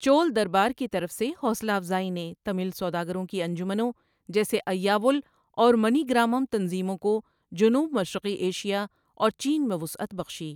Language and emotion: Urdu, neutral